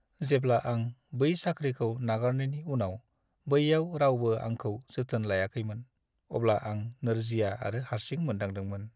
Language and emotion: Bodo, sad